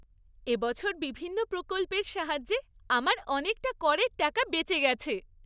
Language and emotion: Bengali, happy